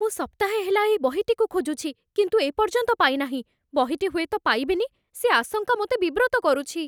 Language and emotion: Odia, fearful